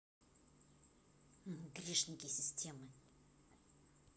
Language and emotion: Russian, neutral